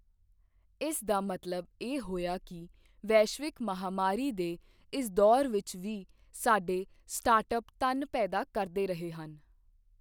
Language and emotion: Punjabi, neutral